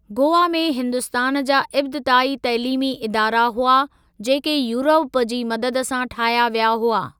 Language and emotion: Sindhi, neutral